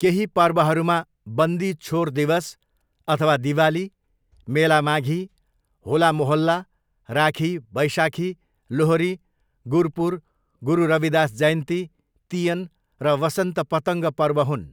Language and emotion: Nepali, neutral